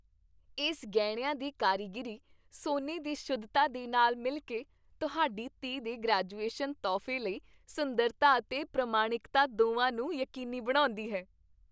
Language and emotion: Punjabi, happy